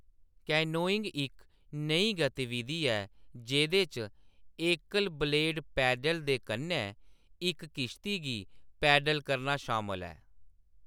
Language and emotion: Dogri, neutral